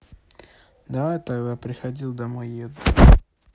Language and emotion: Russian, neutral